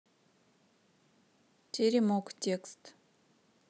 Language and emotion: Russian, neutral